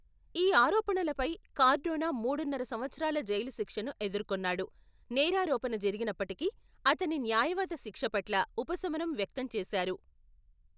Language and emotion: Telugu, neutral